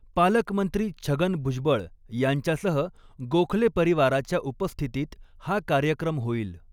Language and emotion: Marathi, neutral